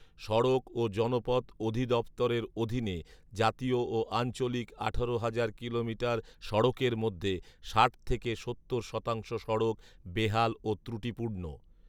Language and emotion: Bengali, neutral